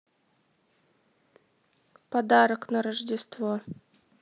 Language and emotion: Russian, neutral